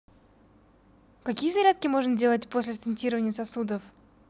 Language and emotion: Russian, positive